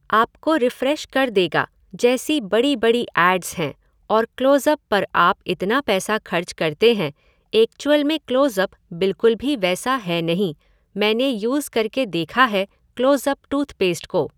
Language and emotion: Hindi, neutral